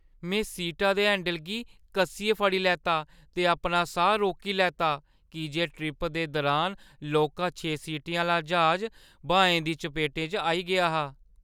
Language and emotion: Dogri, fearful